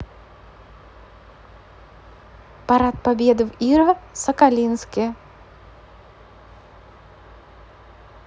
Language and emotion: Russian, neutral